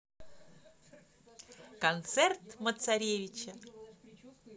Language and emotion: Russian, positive